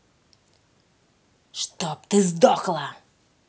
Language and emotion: Russian, angry